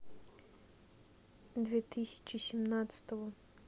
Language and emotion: Russian, neutral